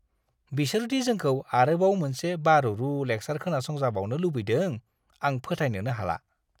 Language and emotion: Bodo, disgusted